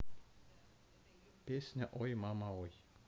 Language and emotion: Russian, neutral